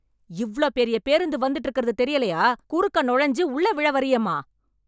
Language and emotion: Tamil, angry